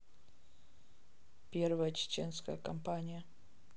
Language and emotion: Russian, neutral